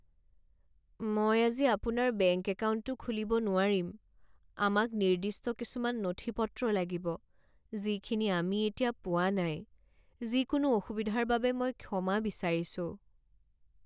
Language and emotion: Assamese, sad